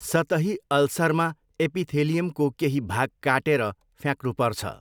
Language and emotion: Nepali, neutral